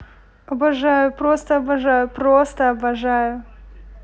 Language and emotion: Russian, positive